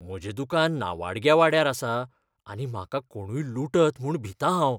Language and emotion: Goan Konkani, fearful